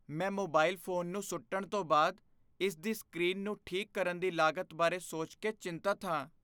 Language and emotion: Punjabi, fearful